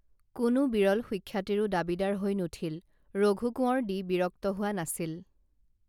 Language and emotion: Assamese, neutral